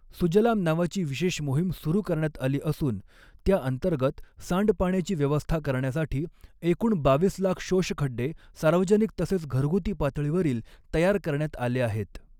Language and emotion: Marathi, neutral